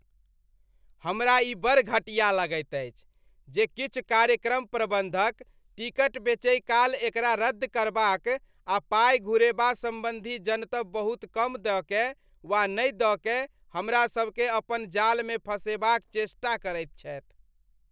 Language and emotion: Maithili, disgusted